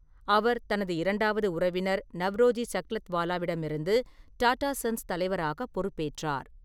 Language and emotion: Tamil, neutral